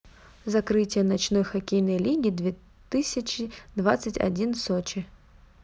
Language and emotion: Russian, neutral